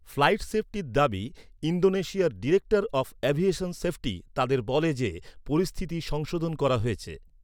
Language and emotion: Bengali, neutral